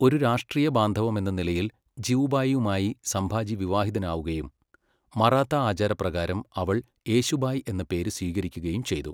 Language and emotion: Malayalam, neutral